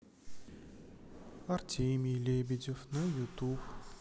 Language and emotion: Russian, sad